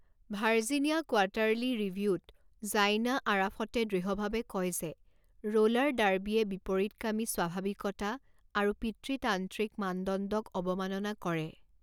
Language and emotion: Assamese, neutral